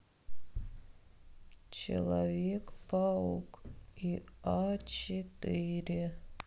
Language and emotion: Russian, sad